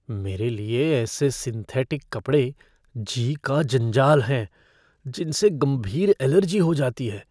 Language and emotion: Hindi, fearful